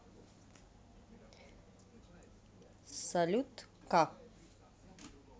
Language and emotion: Russian, neutral